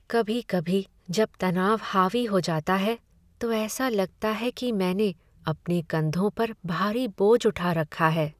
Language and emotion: Hindi, sad